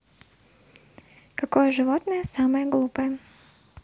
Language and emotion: Russian, neutral